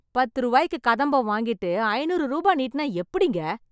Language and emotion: Tamil, angry